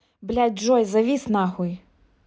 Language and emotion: Russian, angry